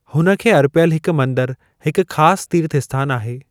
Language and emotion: Sindhi, neutral